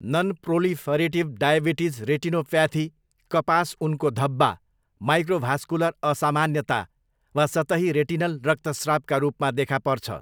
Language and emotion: Nepali, neutral